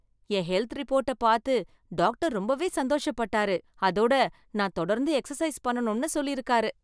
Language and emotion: Tamil, happy